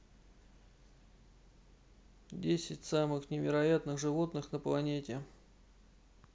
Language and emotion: Russian, neutral